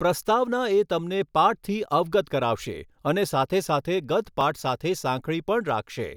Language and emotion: Gujarati, neutral